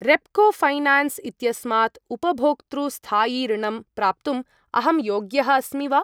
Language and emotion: Sanskrit, neutral